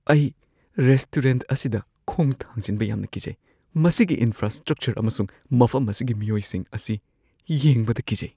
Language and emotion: Manipuri, fearful